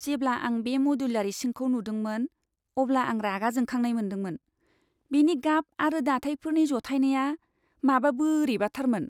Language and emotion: Bodo, disgusted